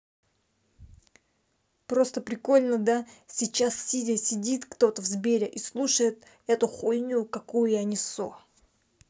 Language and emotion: Russian, angry